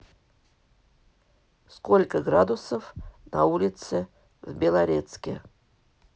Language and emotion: Russian, neutral